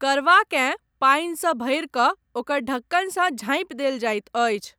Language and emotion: Maithili, neutral